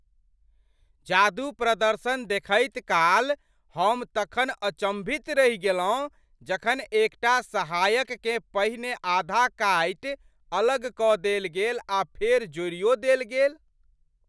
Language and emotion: Maithili, surprised